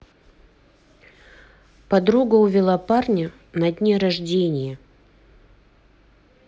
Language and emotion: Russian, neutral